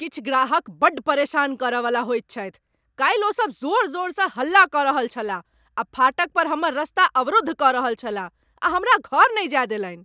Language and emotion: Maithili, angry